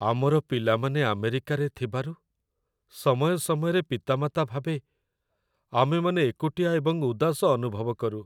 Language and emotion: Odia, sad